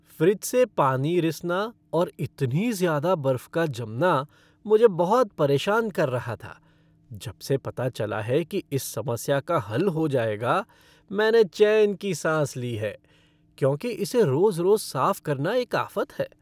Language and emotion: Hindi, happy